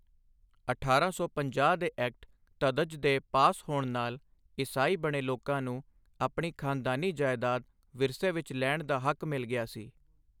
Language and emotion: Punjabi, neutral